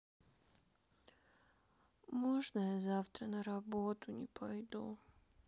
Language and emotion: Russian, sad